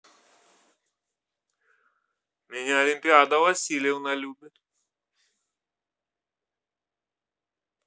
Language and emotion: Russian, positive